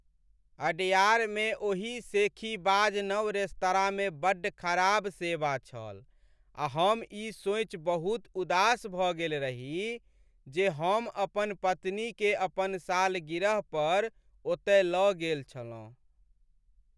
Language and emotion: Maithili, sad